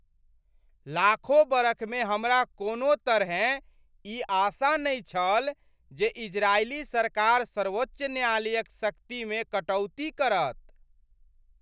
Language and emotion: Maithili, surprised